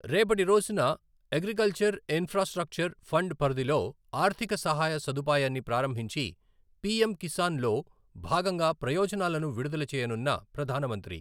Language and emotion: Telugu, neutral